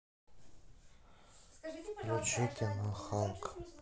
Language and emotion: Russian, sad